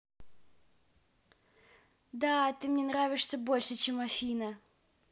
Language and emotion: Russian, positive